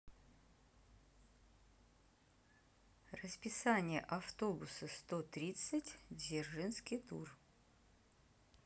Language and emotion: Russian, neutral